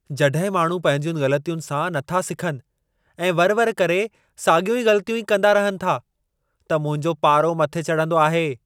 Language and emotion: Sindhi, angry